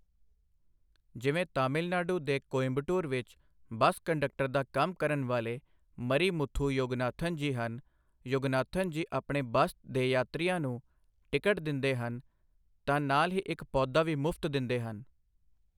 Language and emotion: Punjabi, neutral